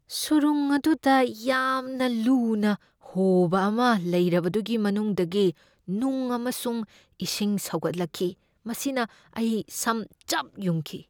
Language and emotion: Manipuri, fearful